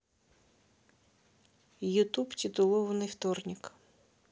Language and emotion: Russian, neutral